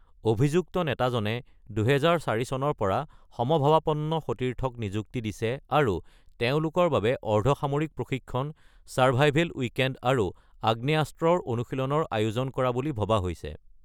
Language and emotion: Assamese, neutral